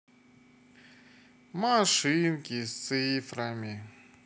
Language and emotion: Russian, sad